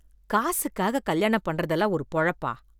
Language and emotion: Tamil, disgusted